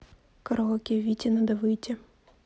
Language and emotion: Russian, neutral